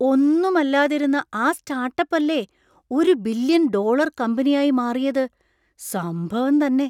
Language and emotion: Malayalam, surprised